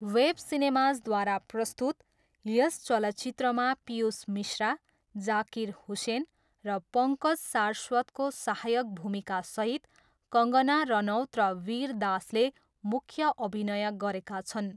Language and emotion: Nepali, neutral